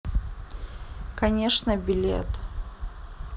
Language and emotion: Russian, sad